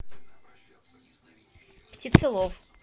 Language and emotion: Russian, neutral